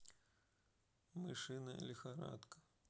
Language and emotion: Russian, sad